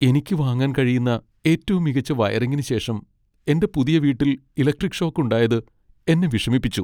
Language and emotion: Malayalam, sad